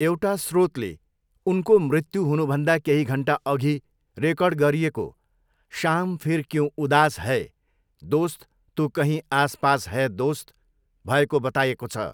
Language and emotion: Nepali, neutral